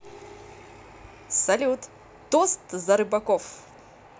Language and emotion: Russian, positive